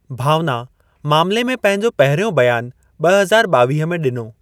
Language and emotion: Sindhi, neutral